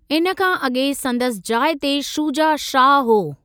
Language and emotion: Sindhi, neutral